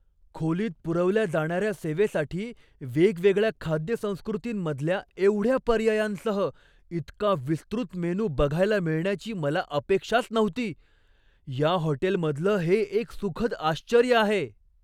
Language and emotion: Marathi, surprised